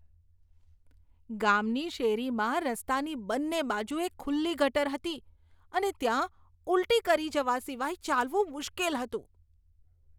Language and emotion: Gujarati, disgusted